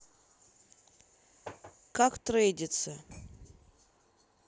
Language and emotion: Russian, neutral